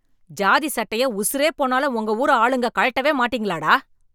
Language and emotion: Tamil, angry